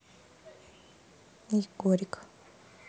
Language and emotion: Russian, sad